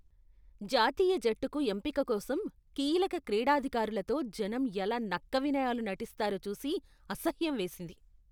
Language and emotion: Telugu, disgusted